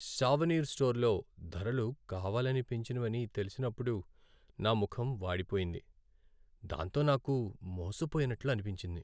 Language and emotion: Telugu, sad